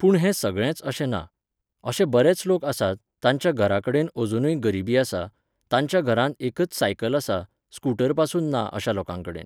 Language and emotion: Goan Konkani, neutral